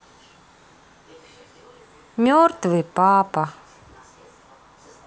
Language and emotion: Russian, sad